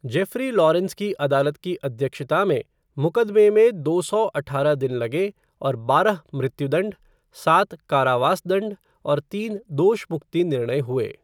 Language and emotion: Hindi, neutral